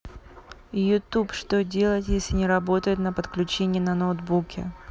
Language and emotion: Russian, neutral